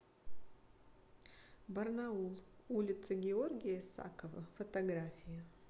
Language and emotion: Russian, neutral